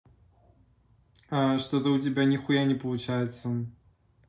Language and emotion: Russian, neutral